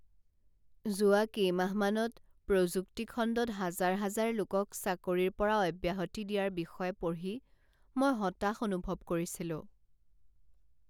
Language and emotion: Assamese, sad